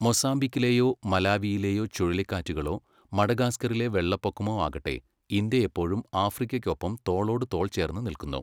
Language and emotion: Malayalam, neutral